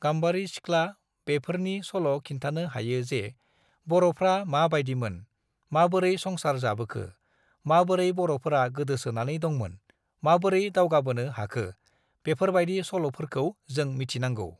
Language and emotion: Bodo, neutral